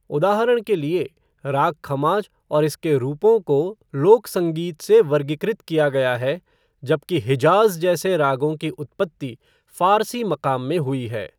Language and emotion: Hindi, neutral